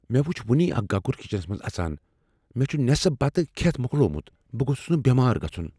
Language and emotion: Kashmiri, fearful